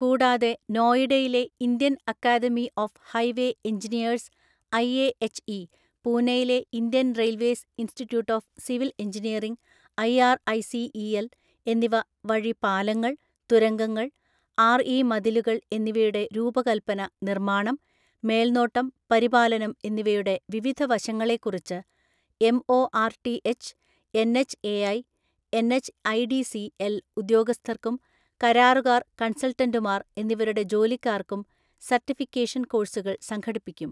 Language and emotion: Malayalam, neutral